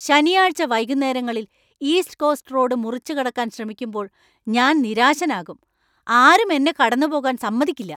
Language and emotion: Malayalam, angry